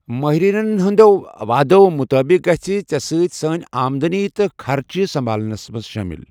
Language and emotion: Kashmiri, neutral